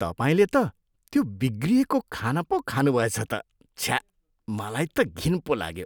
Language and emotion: Nepali, disgusted